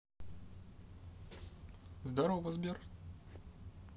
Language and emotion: Russian, positive